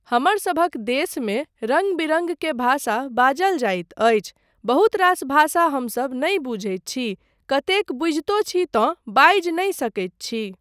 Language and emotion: Maithili, neutral